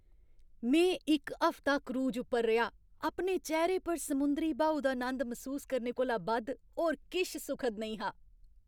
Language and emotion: Dogri, happy